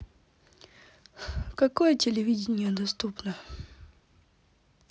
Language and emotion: Russian, neutral